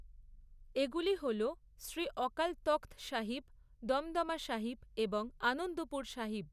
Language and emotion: Bengali, neutral